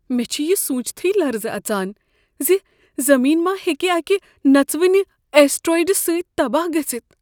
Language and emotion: Kashmiri, fearful